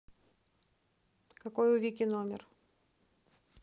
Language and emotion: Russian, neutral